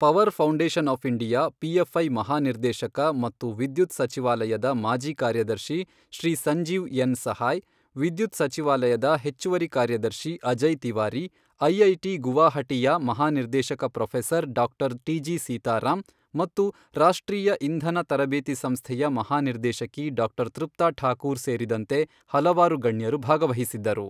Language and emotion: Kannada, neutral